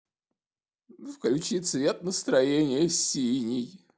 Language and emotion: Russian, sad